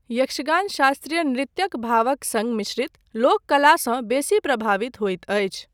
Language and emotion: Maithili, neutral